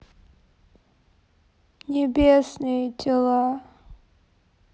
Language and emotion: Russian, sad